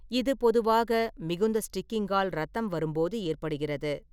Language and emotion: Tamil, neutral